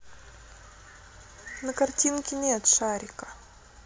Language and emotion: Russian, neutral